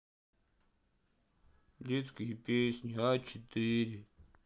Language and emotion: Russian, sad